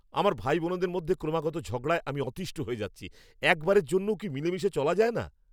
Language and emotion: Bengali, angry